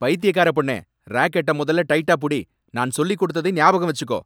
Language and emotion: Tamil, angry